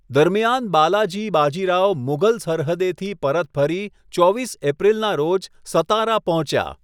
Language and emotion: Gujarati, neutral